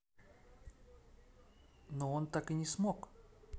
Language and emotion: Russian, neutral